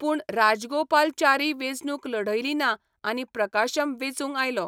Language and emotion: Goan Konkani, neutral